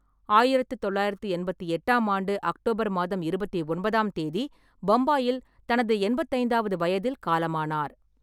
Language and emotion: Tamil, neutral